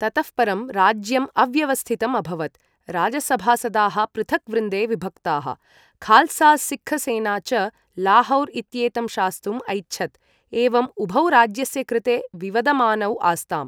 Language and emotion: Sanskrit, neutral